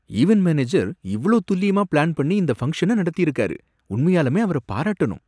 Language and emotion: Tamil, surprised